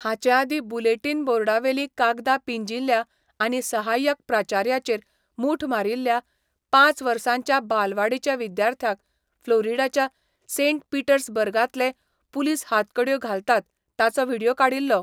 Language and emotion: Goan Konkani, neutral